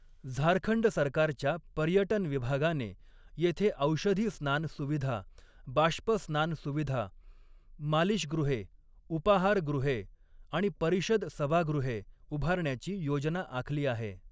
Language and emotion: Marathi, neutral